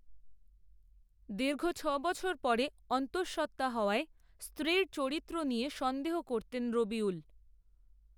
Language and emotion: Bengali, neutral